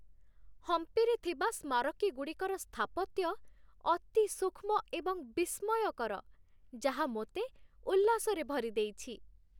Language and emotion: Odia, happy